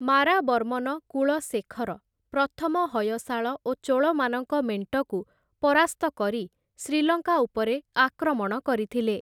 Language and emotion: Odia, neutral